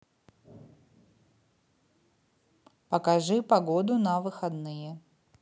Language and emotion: Russian, neutral